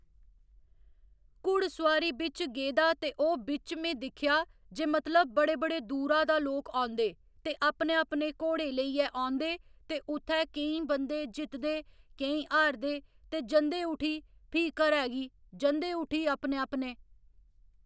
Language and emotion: Dogri, neutral